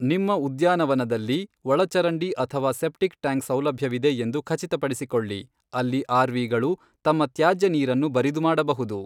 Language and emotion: Kannada, neutral